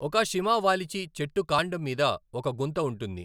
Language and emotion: Telugu, neutral